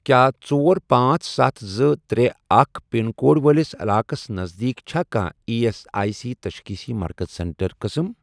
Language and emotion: Kashmiri, neutral